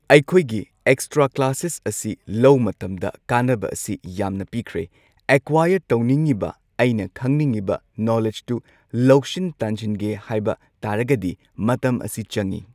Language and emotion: Manipuri, neutral